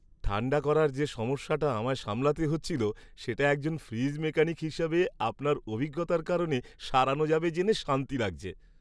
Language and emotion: Bengali, happy